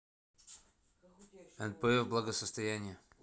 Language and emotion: Russian, neutral